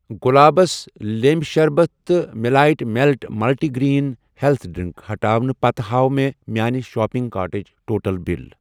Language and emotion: Kashmiri, neutral